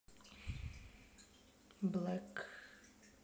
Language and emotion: Russian, neutral